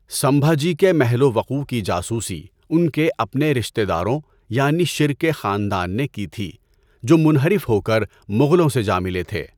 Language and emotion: Urdu, neutral